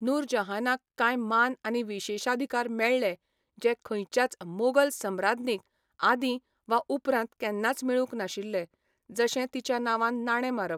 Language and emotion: Goan Konkani, neutral